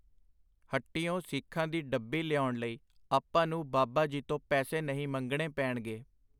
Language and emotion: Punjabi, neutral